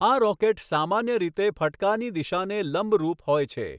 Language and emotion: Gujarati, neutral